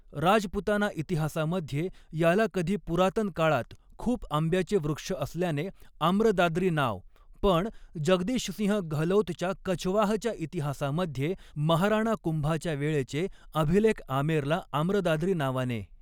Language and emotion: Marathi, neutral